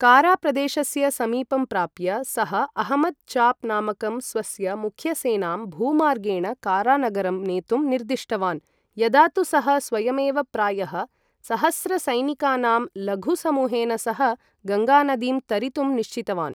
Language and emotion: Sanskrit, neutral